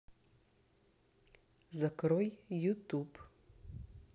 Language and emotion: Russian, neutral